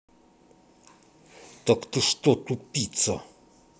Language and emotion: Russian, angry